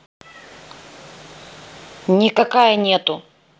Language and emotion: Russian, angry